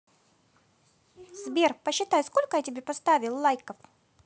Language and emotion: Russian, positive